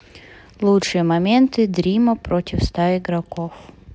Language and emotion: Russian, neutral